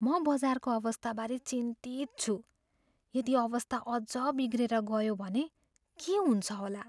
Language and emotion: Nepali, fearful